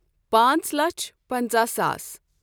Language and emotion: Kashmiri, neutral